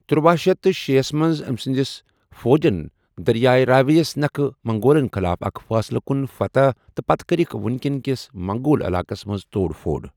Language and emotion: Kashmiri, neutral